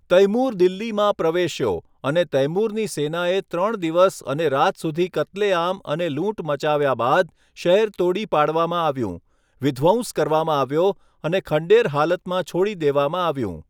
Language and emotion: Gujarati, neutral